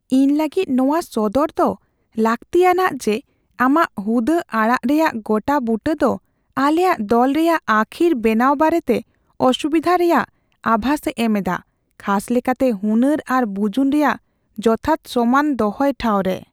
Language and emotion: Santali, fearful